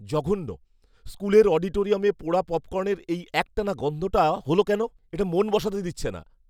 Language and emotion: Bengali, disgusted